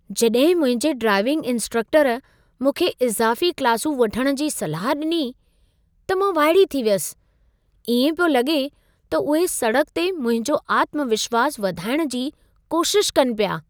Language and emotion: Sindhi, surprised